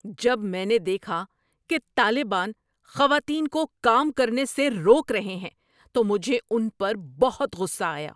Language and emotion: Urdu, angry